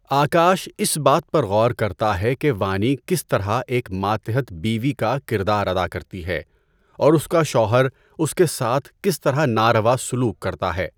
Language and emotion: Urdu, neutral